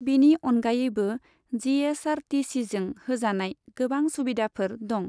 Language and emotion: Bodo, neutral